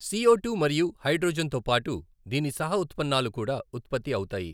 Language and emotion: Telugu, neutral